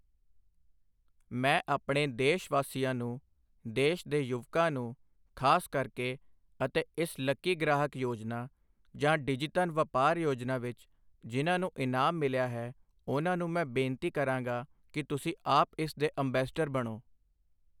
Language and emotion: Punjabi, neutral